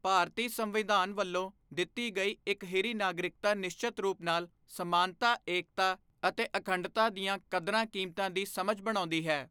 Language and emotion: Punjabi, neutral